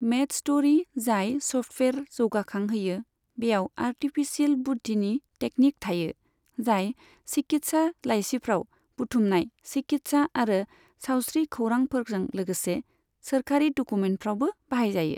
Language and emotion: Bodo, neutral